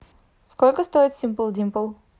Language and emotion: Russian, neutral